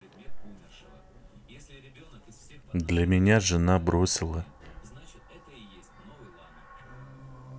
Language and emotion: Russian, neutral